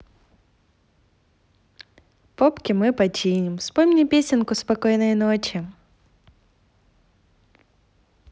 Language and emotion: Russian, positive